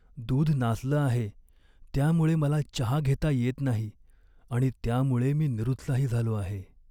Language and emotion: Marathi, sad